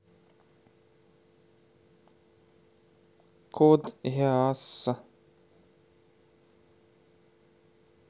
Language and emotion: Russian, neutral